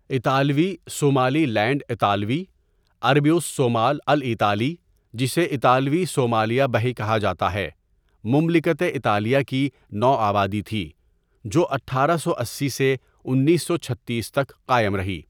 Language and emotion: Urdu, neutral